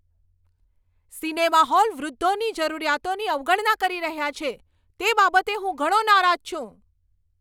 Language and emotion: Gujarati, angry